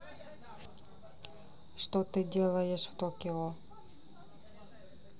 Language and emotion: Russian, neutral